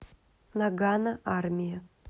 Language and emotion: Russian, neutral